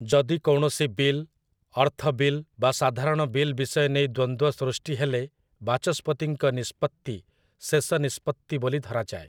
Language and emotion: Odia, neutral